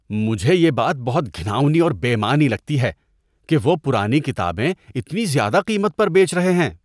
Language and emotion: Urdu, disgusted